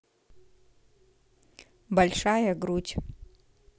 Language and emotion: Russian, neutral